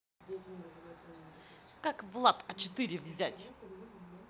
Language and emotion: Russian, angry